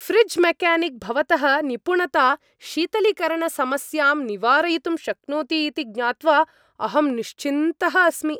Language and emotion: Sanskrit, happy